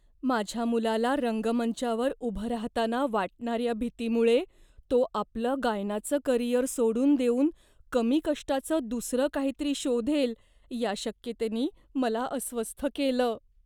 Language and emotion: Marathi, fearful